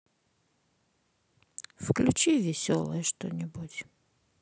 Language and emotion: Russian, sad